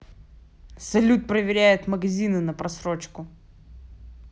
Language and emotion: Russian, angry